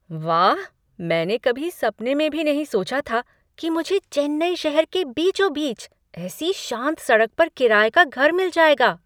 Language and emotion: Hindi, surprised